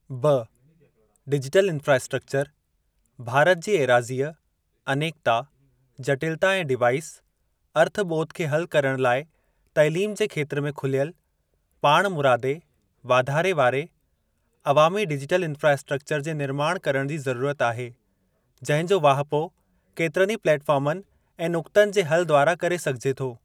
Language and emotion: Sindhi, neutral